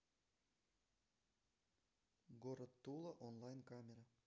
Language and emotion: Russian, neutral